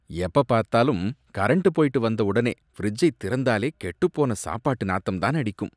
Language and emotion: Tamil, disgusted